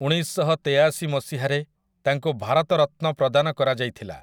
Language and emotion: Odia, neutral